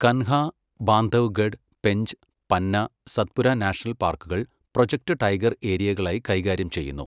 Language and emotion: Malayalam, neutral